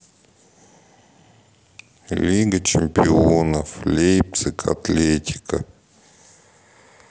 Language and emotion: Russian, sad